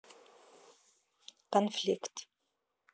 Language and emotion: Russian, neutral